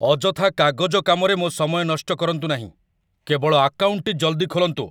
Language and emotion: Odia, angry